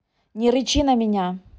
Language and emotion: Russian, angry